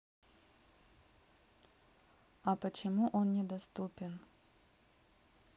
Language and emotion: Russian, neutral